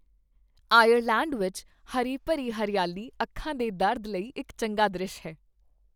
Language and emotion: Punjabi, happy